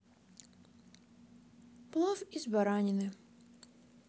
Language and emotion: Russian, neutral